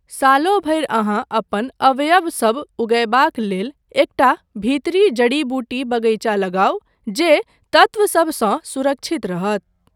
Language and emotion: Maithili, neutral